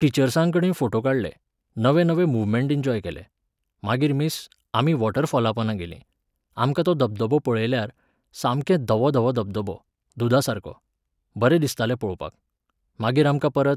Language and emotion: Goan Konkani, neutral